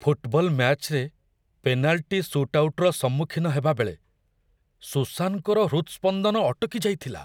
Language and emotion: Odia, fearful